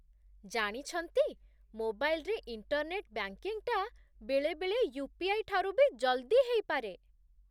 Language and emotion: Odia, surprised